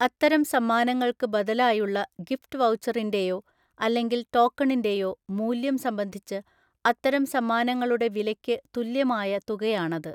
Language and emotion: Malayalam, neutral